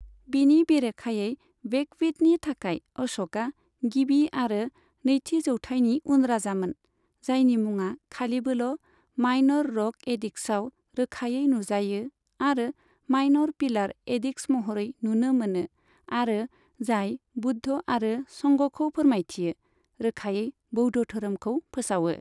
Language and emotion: Bodo, neutral